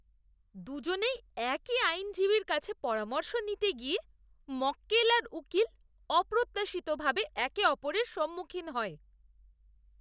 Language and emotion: Bengali, disgusted